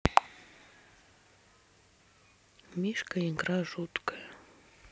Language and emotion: Russian, sad